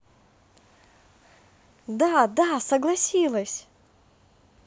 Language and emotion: Russian, positive